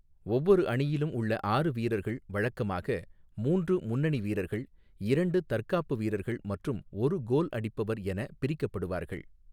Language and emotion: Tamil, neutral